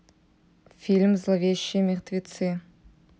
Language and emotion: Russian, neutral